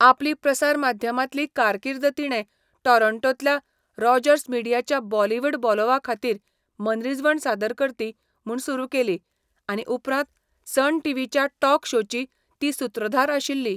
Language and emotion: Goan Konkani, neutral